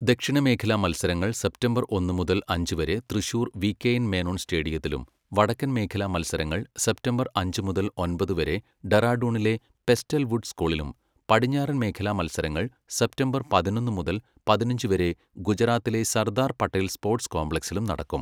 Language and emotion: Malayalam, neutral